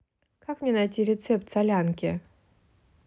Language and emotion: Russian, neutral